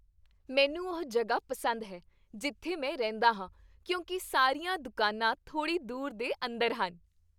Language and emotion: Punjabi, happy